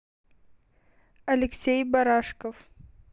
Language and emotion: Russian, neutral